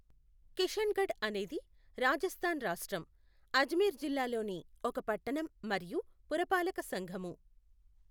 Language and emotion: Telugu, neutral